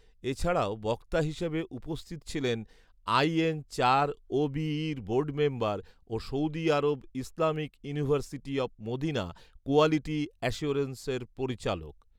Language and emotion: Bengali, neutral